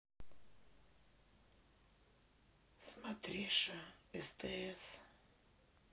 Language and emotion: Russian, sad